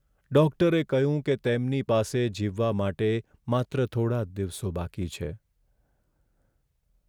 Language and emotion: Gujarati, sad